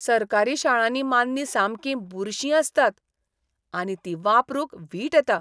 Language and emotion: Goan Konkani, disgusted